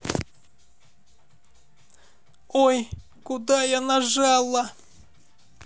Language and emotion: Russian, neutral